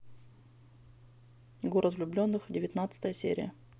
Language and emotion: Russian, neutral